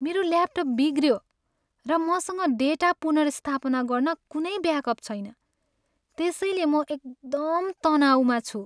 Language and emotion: Nepali, sad